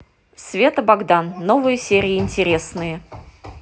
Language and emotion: Russian, positive